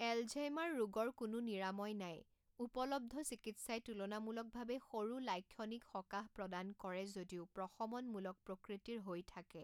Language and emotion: Assamese, neutral